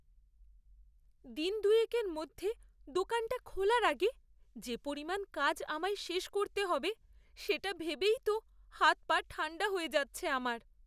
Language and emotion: Bengali, fearful